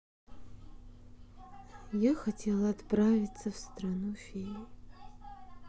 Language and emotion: Russian, sad